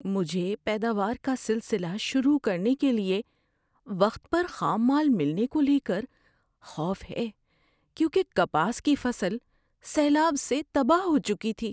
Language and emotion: Urdu, fearful